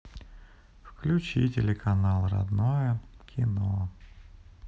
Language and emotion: Russian, sad